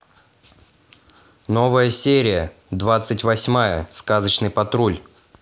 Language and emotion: Russian, positive